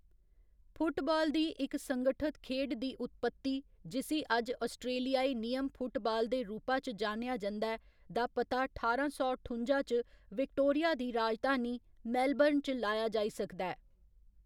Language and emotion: Dogri, neutral